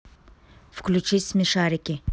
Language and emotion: Russian, neutral